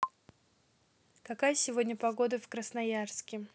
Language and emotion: Russian, neutral